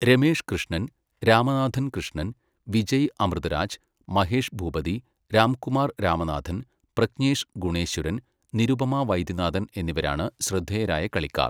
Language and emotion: Malayalam, neutral